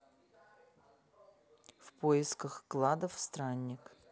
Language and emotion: Russian, neutral